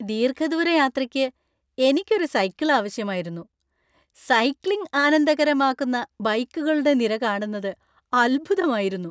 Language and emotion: Malayalam, happy